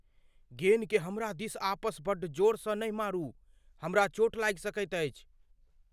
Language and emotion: Maithili, fearful